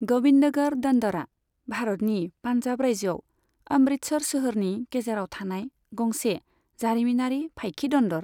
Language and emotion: Bodo, neutral